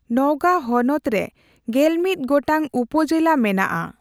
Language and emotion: Santali, neutral